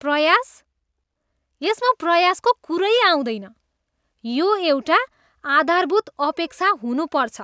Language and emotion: Nepali, disgusted